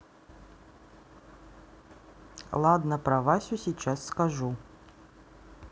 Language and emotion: Russian, neutral